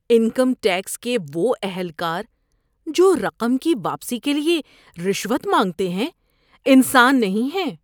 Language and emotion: Urdu, disgusted